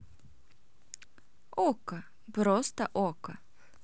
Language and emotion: Russian, neutral